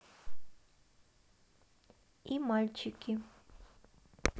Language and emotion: Russian, neutral